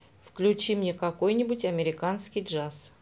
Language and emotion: Russian, neutral